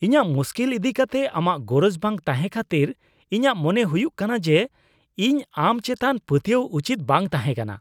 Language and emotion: Santali, disgusted